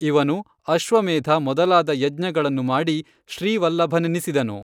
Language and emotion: Kannada, neutral